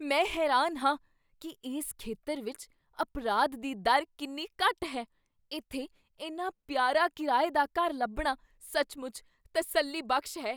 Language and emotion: Punjabi, surprised